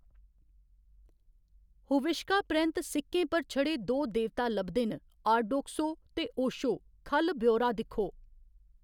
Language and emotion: Dogri, neutral